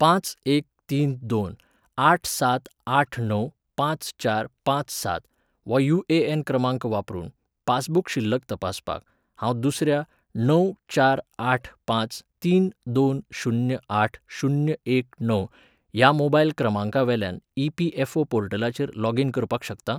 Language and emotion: Goan Konkani, neutral